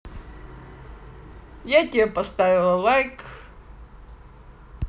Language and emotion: Russian, positive